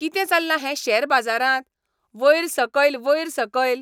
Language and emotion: Goan Konkani, angry